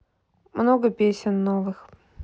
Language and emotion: Russian, neutral